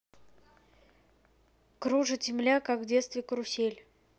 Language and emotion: Russian, neutral